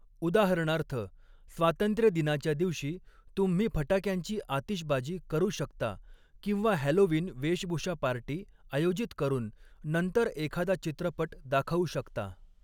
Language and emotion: Marathi, neutral